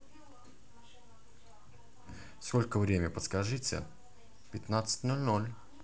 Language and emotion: Russian, neutral